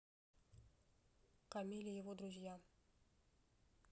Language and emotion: Russian, neutral